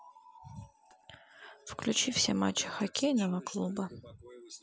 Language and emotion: Russian, neutral